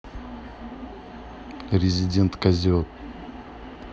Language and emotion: Russian, neutral